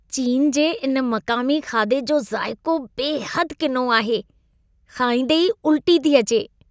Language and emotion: Sindhi, disgusted